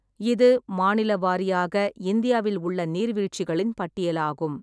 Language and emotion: Tamil, neutral